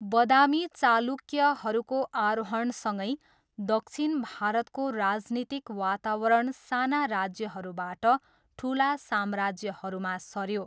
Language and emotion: Nepali, neutral